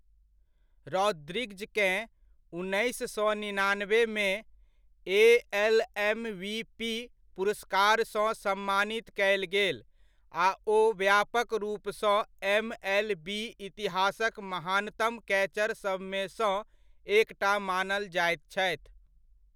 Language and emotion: Maithili, neutral